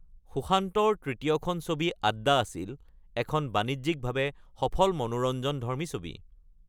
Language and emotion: Assamese, neutral